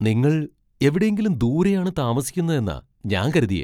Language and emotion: Malayalam, surprised